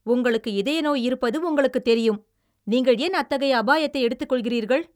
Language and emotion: Tamil, angry